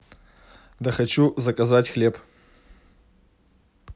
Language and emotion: Russian, neutral